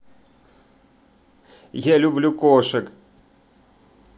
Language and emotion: Russian, positive